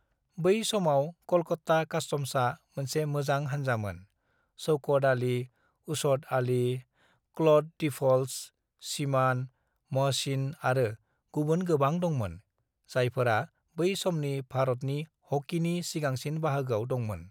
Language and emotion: Bodo, neutral